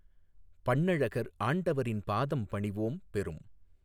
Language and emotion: Tamil, neutral